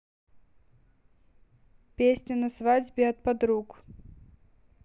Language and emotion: Russian, neutral